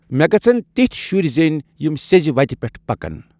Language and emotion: Kashmiri, neutral